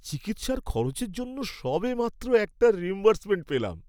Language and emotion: Bengali, happy